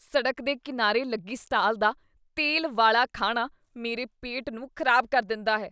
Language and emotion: Punjabi, disgusted